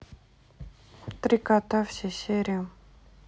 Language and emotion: Russian, neutral